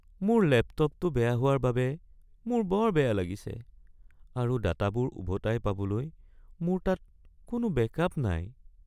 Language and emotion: Assamese, sad